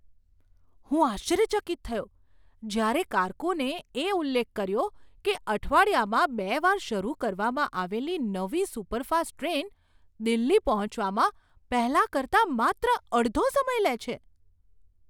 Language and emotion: Gujarati, surprised